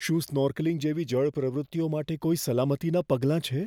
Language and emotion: Gujarati, fearful